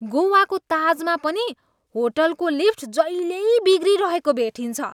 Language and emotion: Nepali, disgusted